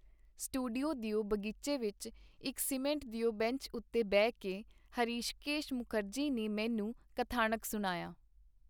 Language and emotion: Punjabi, neutral